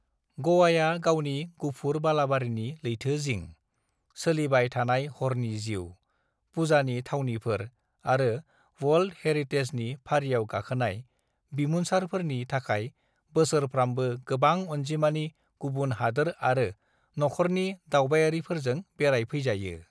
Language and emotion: Bodo, neutral